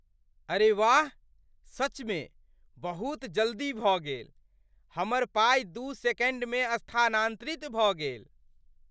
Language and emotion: Maithili, surprised